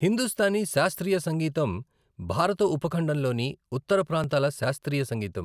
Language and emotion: Telugu, neutral